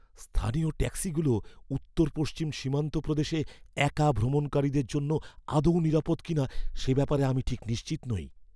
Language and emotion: Bengali, fearful